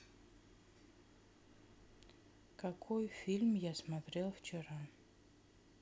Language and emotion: Russian, neutral